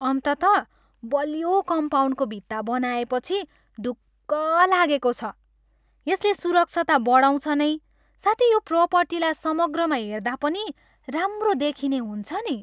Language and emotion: Nepali, happy